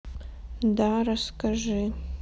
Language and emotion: Russian, sad